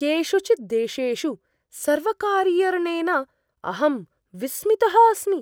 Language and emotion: Sanskrit, surprised